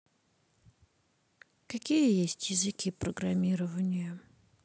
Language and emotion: Russian, sad